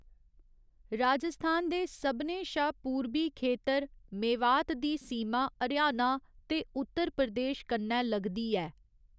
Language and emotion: Dogri, neutral